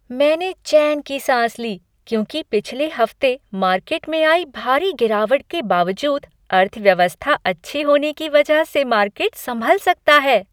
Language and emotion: Hindi, happy